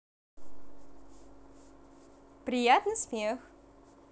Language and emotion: Russian, positive